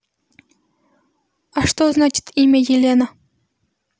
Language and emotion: Russian, neutral